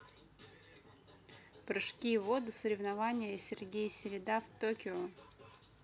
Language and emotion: Russian, neutral